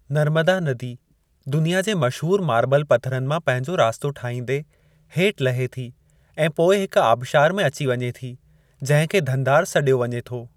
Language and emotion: Sindhi, neutral